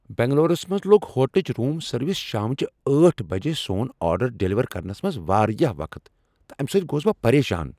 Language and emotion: Kashmiri, angry